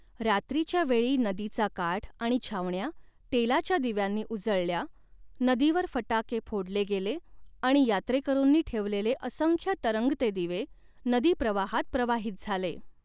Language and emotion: Marathi, neutral